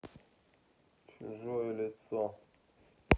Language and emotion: Russian, neutral